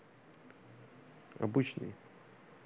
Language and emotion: Russian, neutral